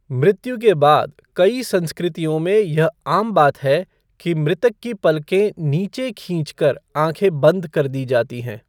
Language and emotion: Hindi, neutral